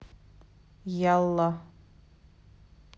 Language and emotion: Russian, neutral